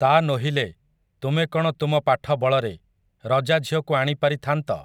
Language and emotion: Odia, neutral